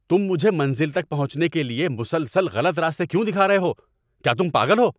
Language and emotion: Urdu, angry